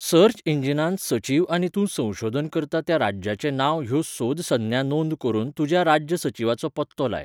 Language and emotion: Goan Konkani, neutral